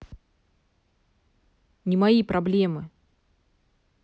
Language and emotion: Russian, angry